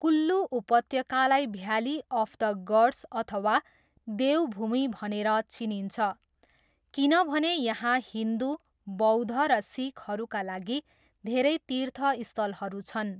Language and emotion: Nepali, neutral